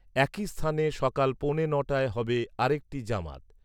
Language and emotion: Bengali, neutral